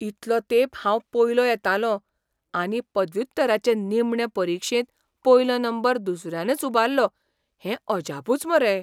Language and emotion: Goan Konkani, surprised